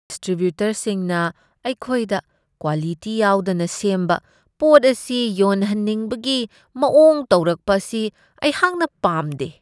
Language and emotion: Manipuri, disgusted